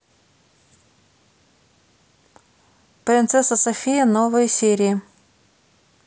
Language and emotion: Russian, neutral